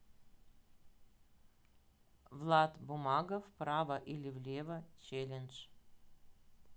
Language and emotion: Russian, neutral